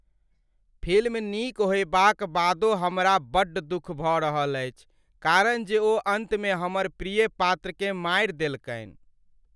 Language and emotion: Maithili, sad